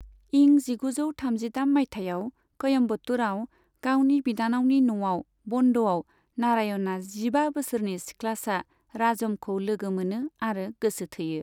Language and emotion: Bodo, neutral